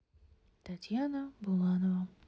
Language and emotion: Russian, neutral